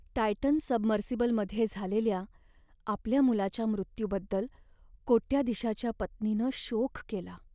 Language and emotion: Marathi, sad